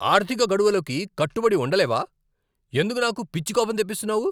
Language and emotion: Telugu, angry